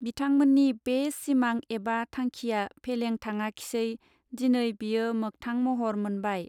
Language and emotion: Bodo, neutral